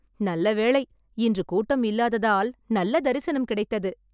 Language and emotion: Tamil, happy